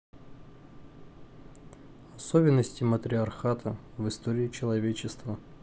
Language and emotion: Russian, neutral